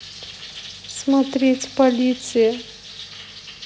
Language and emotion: Russian, sad